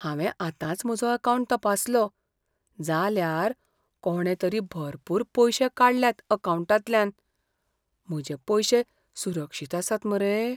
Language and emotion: Goan Konkani, fearful